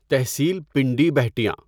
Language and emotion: Urdu, neutral